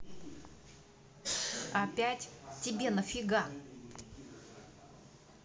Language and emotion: Russian, angry